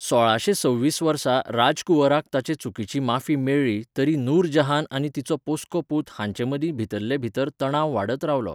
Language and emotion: Goan Konkani, neutral